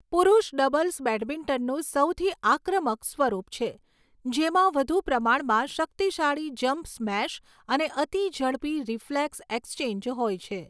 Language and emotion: Gujarati, neutral